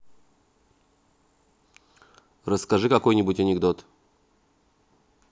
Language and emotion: Russian, neutral